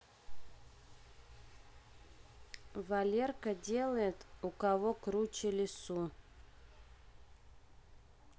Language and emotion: Russian, neutral